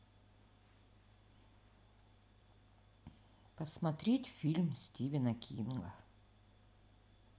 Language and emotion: Russian, neutral